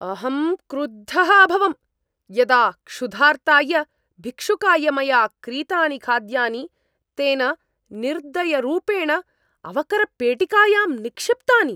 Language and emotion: Sanskrit, angry